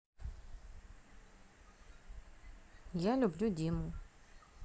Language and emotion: Russian, neutral